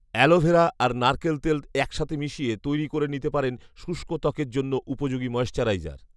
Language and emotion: Bengali, neutral